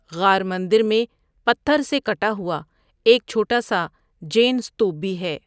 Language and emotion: Urdu, neutral